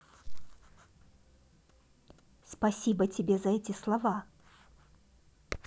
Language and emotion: Russian, positive